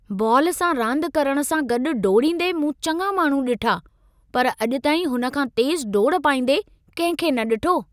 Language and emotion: Sindhi, surprised